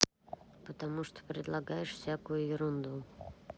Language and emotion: Russian, neutral